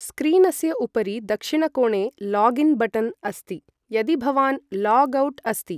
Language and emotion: Sanskrit, neutral